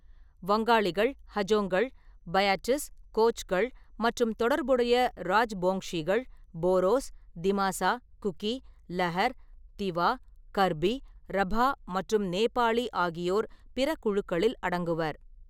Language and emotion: Tamil, neutral